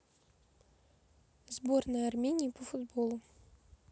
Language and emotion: Russian, neutral